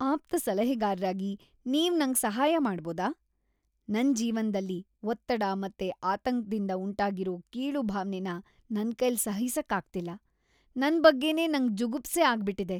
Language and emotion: Kannada, disgusted